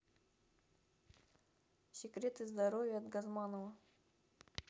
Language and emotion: Russian, neutral